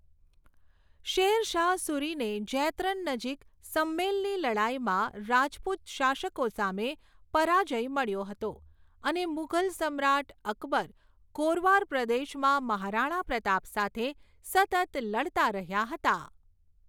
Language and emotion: Gujarati, neutral